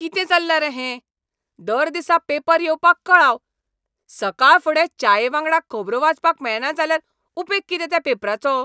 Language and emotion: Goan Konkani, angry